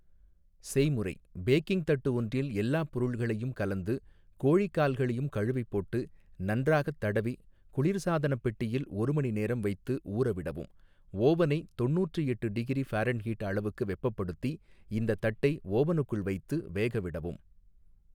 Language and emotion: Tamil, neutral